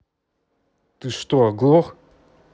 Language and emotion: Russian, angry